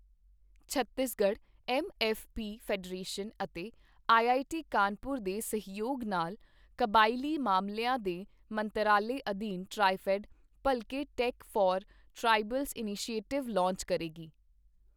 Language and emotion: Punjabi, neutral